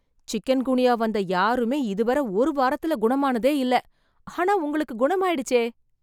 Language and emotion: Tamil, surprised